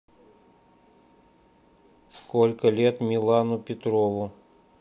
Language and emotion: Russian, neutral